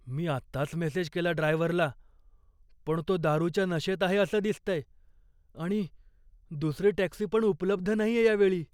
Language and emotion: Marathi, fearful